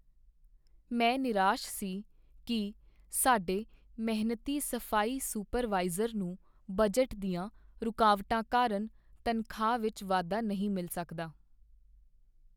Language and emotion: Punjabi, sad